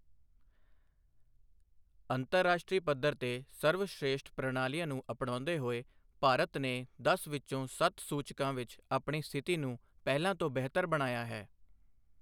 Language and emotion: Punjabi, neutral